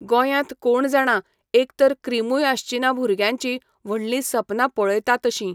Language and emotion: Goan Konkani, neutral